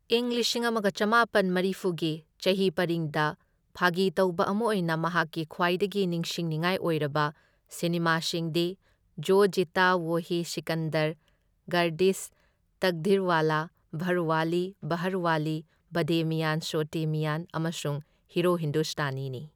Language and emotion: Manipuri, neutral